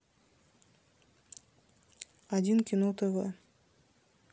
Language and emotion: Russian, neutral